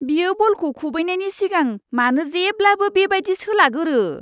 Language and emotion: Bodo, disgusted